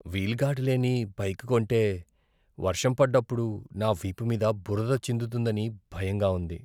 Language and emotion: Telugu, fearful